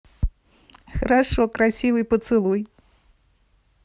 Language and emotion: Russian, positive